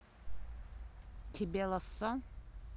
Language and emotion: Russian, neutral